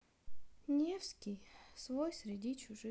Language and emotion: Russian, sad